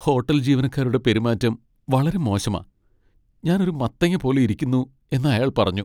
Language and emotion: Malayalam, sad